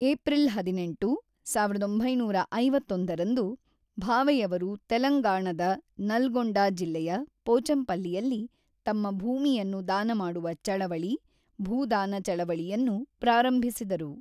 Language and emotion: Kannada, neutral